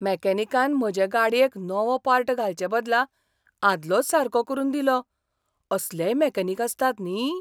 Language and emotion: Goan Konkani, surprised